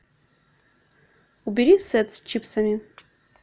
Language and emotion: Russian, neutral